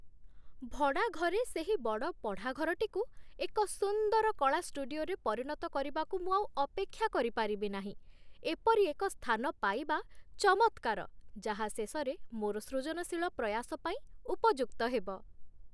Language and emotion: Odia, happy